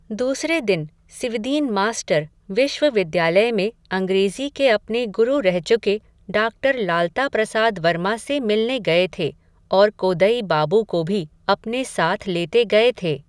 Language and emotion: Hindi, neutral